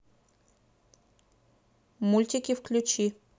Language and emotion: Russian, neutral